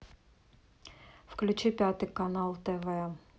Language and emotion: Russian, neutral